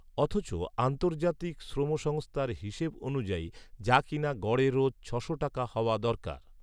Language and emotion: Bengali, neutral